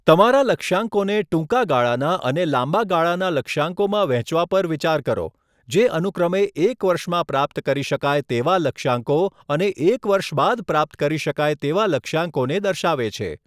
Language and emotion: Gujarati, neutral